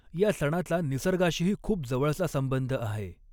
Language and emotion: Marathi, neutral